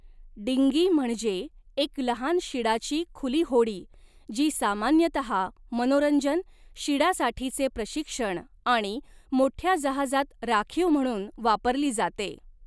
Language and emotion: Marathi, neutral